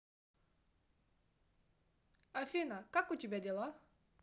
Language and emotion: Russian, positive